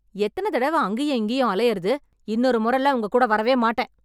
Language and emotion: Tamil, angry